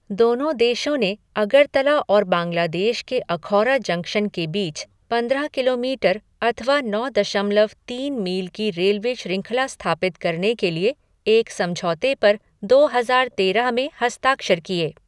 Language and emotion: Hindi, neutral